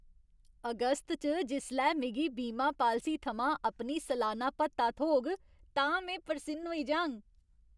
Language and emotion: Dogri, happy